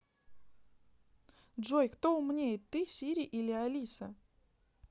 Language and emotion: Russian, neutral